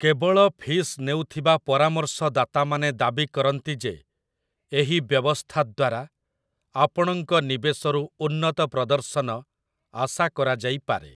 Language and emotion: Odia, neutral